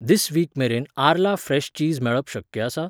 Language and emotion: Goan Konkani, neutral